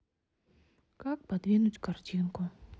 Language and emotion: Russian, sad